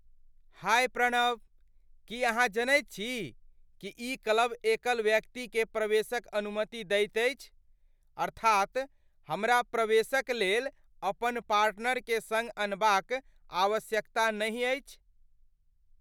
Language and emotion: Maithili, surprised